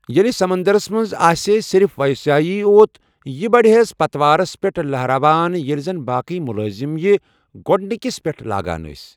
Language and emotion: Kashmiri, neutral